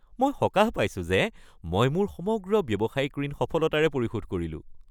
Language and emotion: Assamese, happy